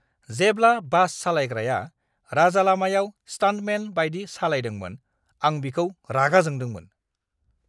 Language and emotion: Bodo, angry